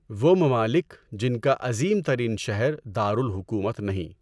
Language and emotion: Urdu, neutral